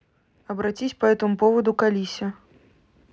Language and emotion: Russian, neutral